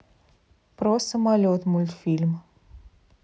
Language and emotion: Russian, neutral